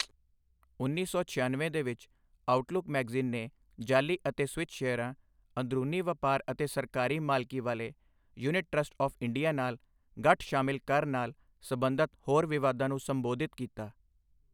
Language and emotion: Punjabi, neutral